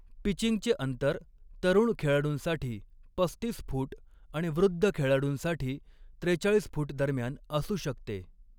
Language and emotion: Marathi, neutral